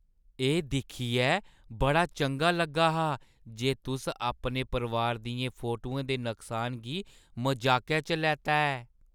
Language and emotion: Dogri, happy